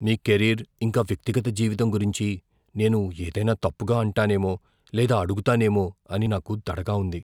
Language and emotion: Telugu, fearful